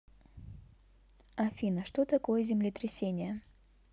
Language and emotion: Russian, neutral